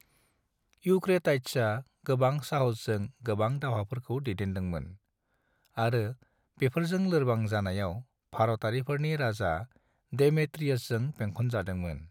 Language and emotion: Bodo, neutral